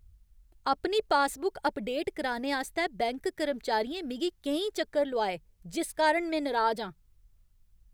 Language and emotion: Dogri, angry